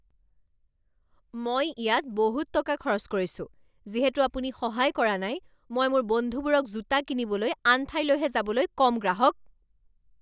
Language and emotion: Assamese, angry